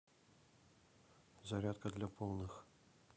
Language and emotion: Russian, neutral